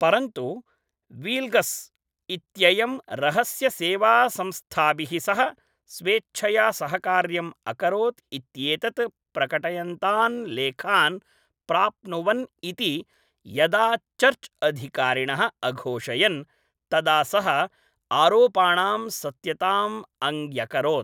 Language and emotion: Sanskrit, neutral